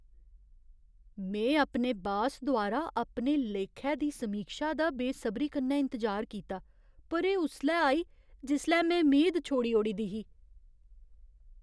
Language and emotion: Dogri, surprised